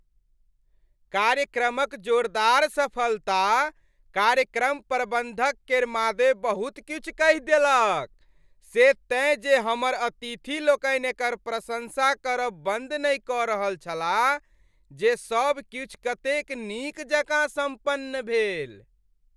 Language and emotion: Maithili, happy